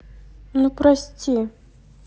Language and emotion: Russian, sad